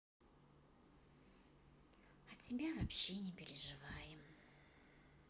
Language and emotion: Russian, neutral